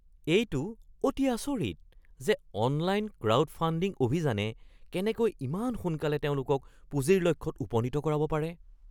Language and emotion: Assamese, surprised